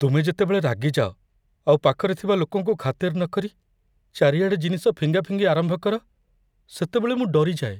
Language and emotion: Odia, fearful